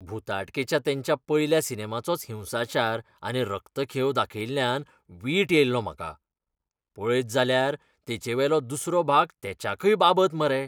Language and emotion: Goan Konkani, disgusted